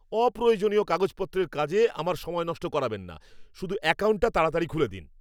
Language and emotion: Bengali, angry